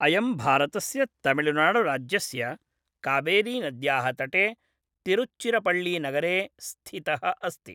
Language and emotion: Sanskrit, neutral